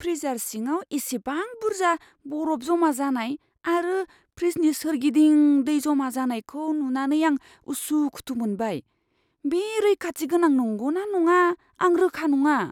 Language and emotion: Bodo, fearful